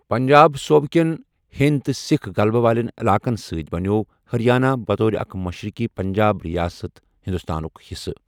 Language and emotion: Kashmiri, neutral